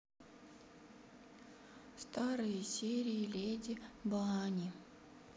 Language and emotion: Russian, sad